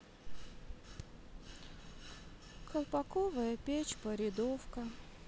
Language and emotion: Russian, sad